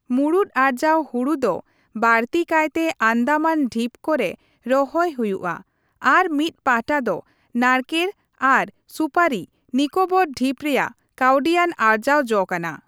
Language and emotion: Santali, neutral